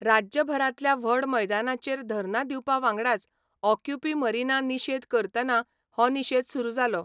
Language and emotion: Goan Konkani, neutral